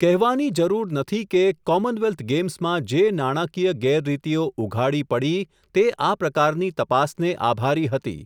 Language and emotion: Gujarati, neutral